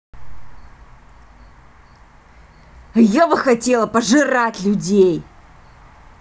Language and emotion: Russian, angry